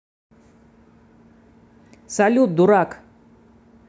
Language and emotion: Russian, angry